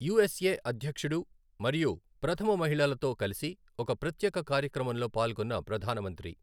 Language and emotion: Telugu, neutral